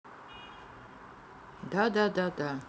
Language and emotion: Russian, neutral